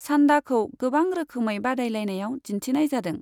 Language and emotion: Bodo, neutral